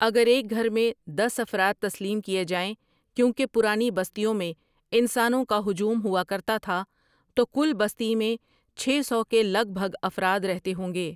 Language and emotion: Urdu, neutral